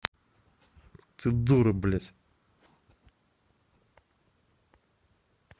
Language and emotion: Russian, angry